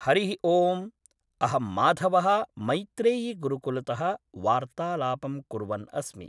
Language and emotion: Sanskrit, neutral